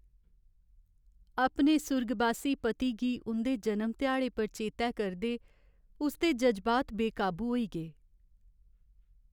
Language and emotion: Dogri, sad